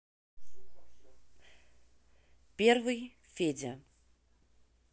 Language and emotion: Russian, neutral